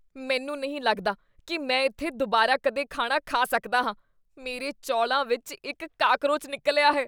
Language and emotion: Punjabi, disgusted